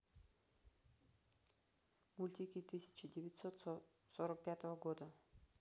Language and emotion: Russian, neutral